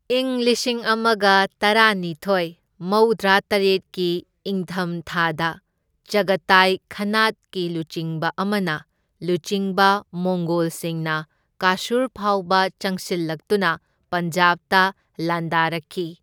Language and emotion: Manipuri, neutral